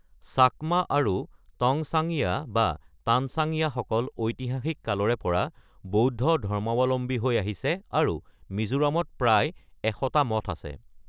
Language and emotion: Assamese, neutral